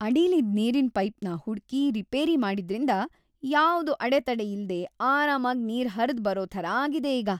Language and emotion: Kannada, happy